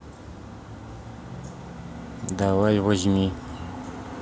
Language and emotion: Russian, neutral